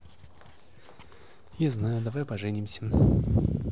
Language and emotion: Russian, neutral